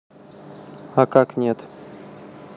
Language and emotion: Russian, neutral